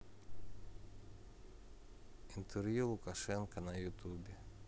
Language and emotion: Russian, neutral